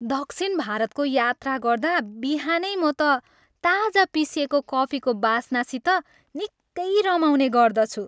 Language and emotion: Nepali, happy